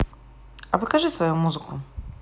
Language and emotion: Russian, neutral